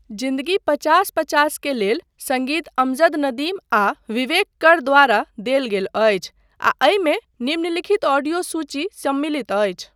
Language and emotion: Maithili, neutral